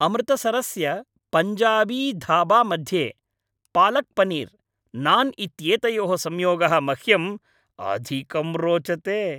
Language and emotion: Sanskrit, happy